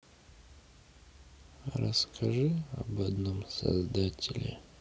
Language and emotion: Russian, sad